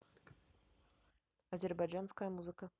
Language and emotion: Russian, neutral